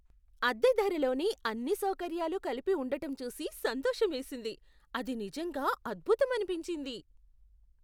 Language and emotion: Telugu, surprised